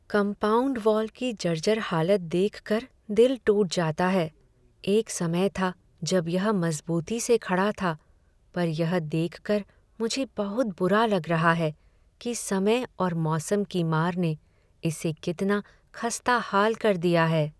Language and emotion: Hindi, sad